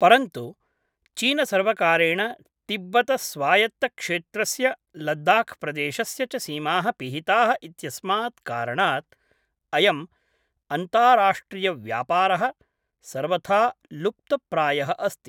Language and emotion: Sanskrit, neutral